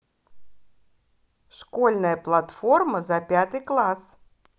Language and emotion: Russian, positive